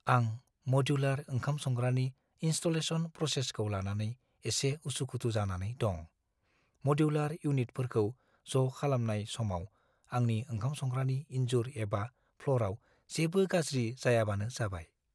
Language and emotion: Bodo, fearful